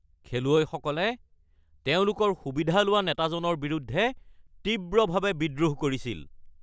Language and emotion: Assamese, angry